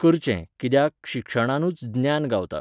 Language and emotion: Goan Konkani, neutral